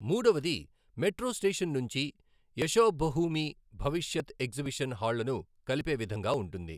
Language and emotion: Telugu, neutral